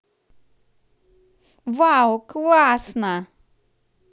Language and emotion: Russian, positive